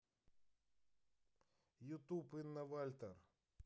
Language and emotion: Russian, neutral